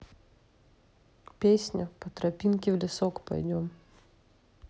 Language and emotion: Russian, neutral